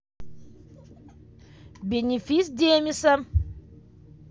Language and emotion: Russian, positive